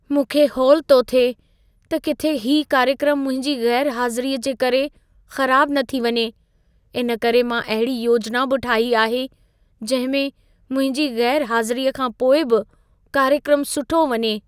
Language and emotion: Sindhi, fearful